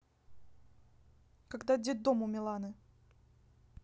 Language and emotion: Russian, neutral